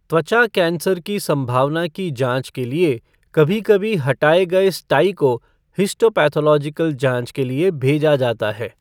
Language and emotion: Hindi, neutral